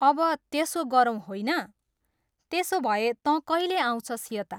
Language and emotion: Nepali, neutral